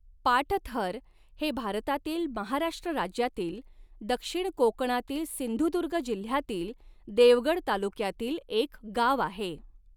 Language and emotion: Marathi, neutral